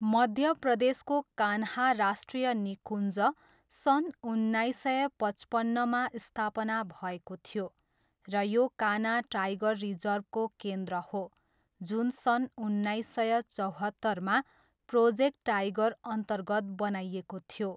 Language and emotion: Nepali, neutral